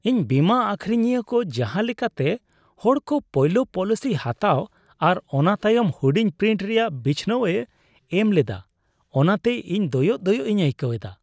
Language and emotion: Santali, disgusted